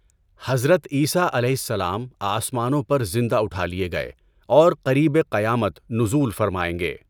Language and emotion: Urdu, neutral